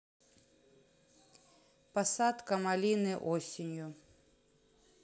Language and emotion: Russian, neutral